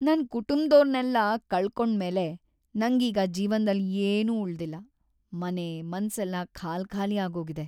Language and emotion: Kannada, sad